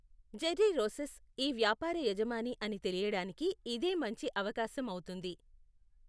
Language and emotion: Telugu, neutral